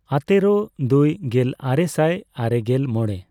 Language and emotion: Santali, neutral